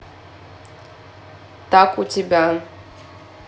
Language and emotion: Russian, neutral